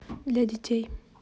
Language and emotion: Russian, neutral